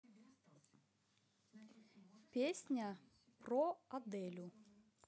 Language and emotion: Russian, neutral